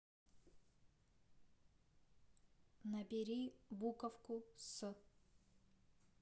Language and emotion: Russian, neutral